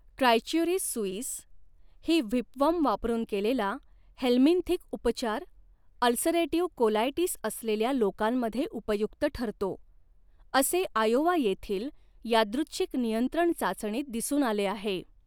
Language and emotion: Marathi, neutral